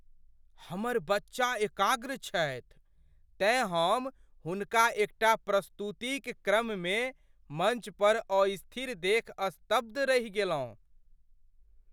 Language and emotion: Maithili, surprised